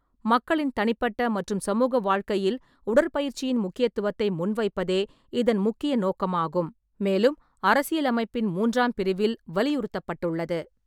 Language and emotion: Tamil, neutral